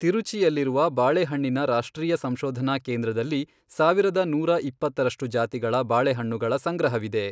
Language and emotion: Kannada, neutral